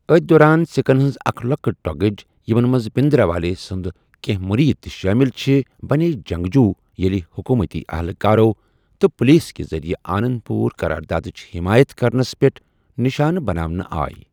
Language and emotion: Kashmiri, neutral